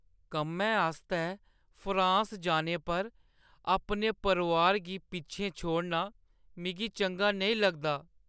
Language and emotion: Dogri, sad